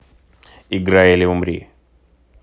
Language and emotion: Russian, neutral